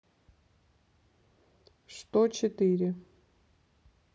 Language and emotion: Russian, neutral